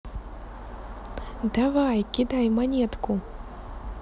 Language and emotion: Russian, positive